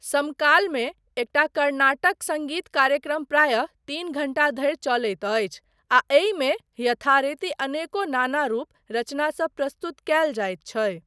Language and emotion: Maithili, neutral